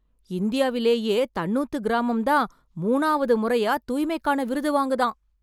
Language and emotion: Tamil, surprised